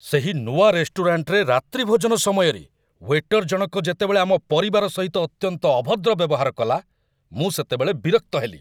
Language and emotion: Odia, angry